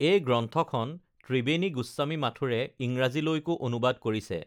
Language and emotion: Assamese, neutral